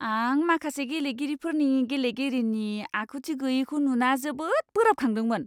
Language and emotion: Bodo, disgusted